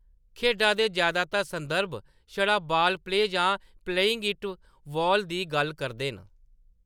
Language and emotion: Dogri, neutral